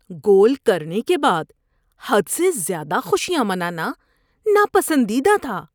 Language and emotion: Urdu, disgusted